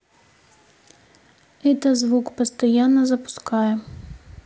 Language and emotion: Russian, neutral